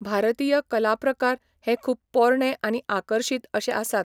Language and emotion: Goan Konkani, neutral